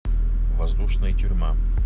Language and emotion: Russian, neutral